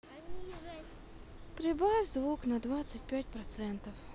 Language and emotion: Russian, sad